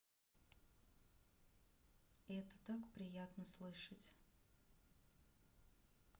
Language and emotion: Russian, sad